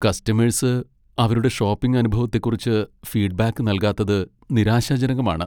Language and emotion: Malayalam, sad